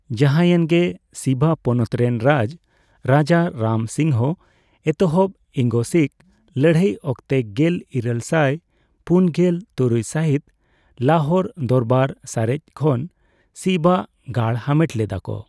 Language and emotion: Santali, neutral